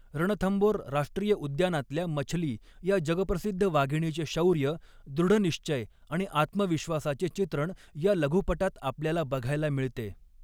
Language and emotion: Marathi, neutral